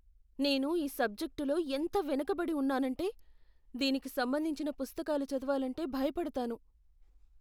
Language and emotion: Telugu, fearful